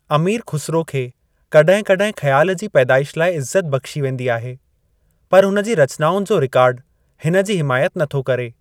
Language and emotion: Sindhi, neutral